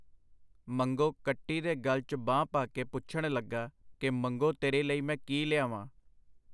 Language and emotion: Punjabi, neutral